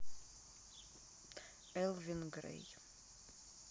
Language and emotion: Russian, neutral